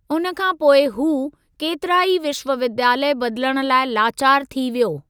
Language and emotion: Sindhi, neutral